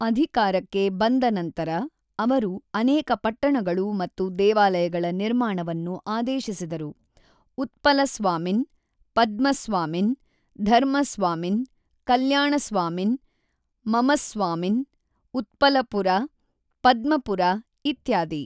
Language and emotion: Kannada, neutral